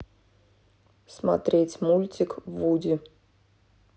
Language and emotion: Russian, neutral